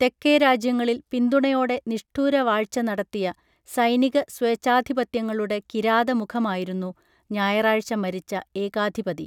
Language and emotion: Malayalam, neutral